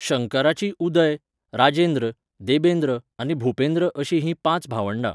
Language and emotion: Goan Konkani, neutral